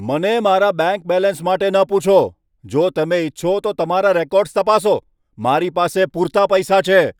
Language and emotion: Gujarati, angry